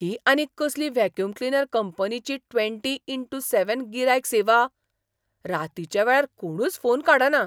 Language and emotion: Goan Konkani, surprised